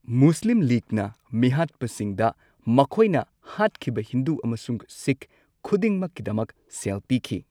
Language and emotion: Manipuri, neutral